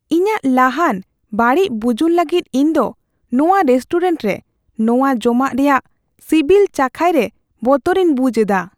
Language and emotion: Santali, fearful